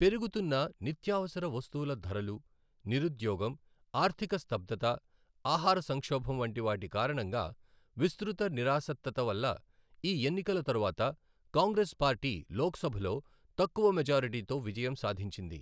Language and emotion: Telugu, neutral